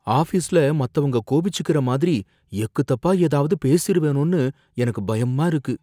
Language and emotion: Tamil, fearful